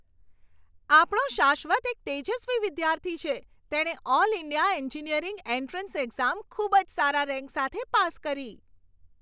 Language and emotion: Gujarati, happy